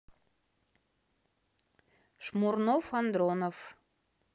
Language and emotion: Russian, neutral